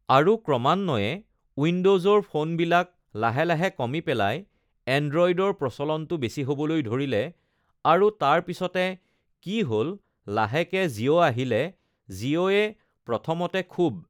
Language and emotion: Assamese, neutral